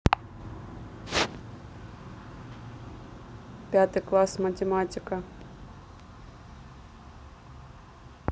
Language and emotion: Russian, neutral